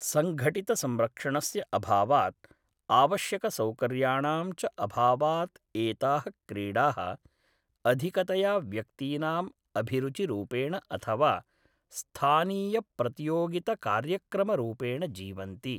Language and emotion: Sanskrit, neutral